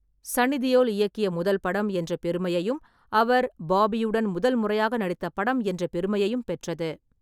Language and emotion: Tamil, neutral